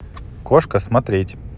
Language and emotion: Russian, neutral